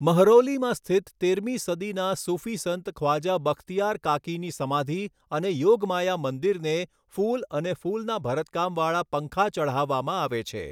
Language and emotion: Gujarati, neutral